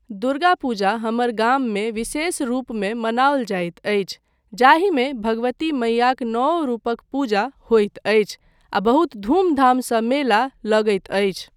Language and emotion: Maithili, neutral